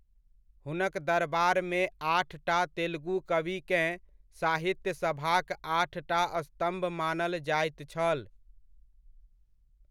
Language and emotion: Maithili, neutral